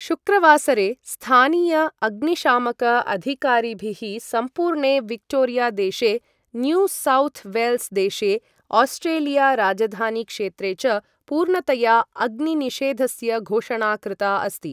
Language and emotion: Sanskrit, neutral